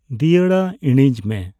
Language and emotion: Santali, neutral